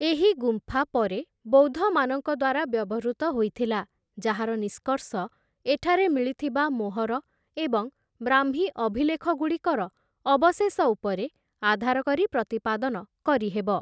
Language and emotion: Odia, neutral